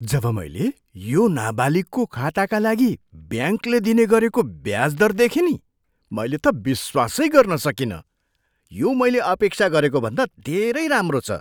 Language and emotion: Nepali, surprised